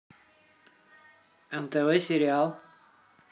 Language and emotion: Russian, neutral